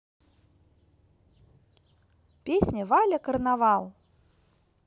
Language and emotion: Russian, positive